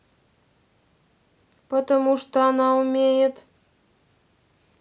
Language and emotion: Russian, neutral